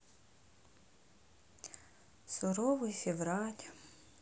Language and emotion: Russian, sad